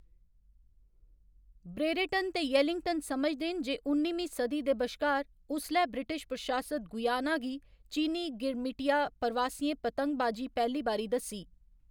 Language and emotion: Dogri, neutral